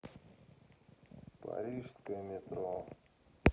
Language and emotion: Russian, neutral